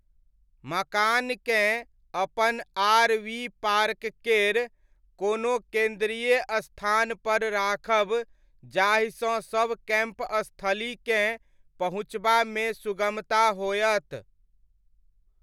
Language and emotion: Maithili, neutral